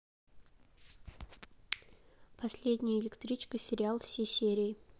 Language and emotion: Russian, neutral